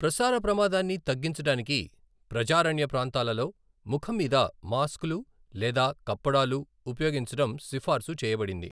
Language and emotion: Telugu, neutral